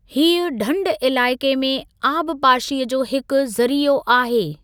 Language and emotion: Sindhi, neutral